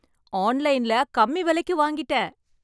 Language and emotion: Tamil, happy